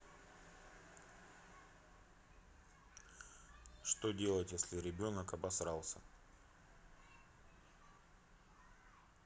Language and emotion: Russian, neutral